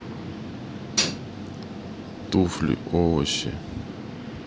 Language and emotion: Russian, neutral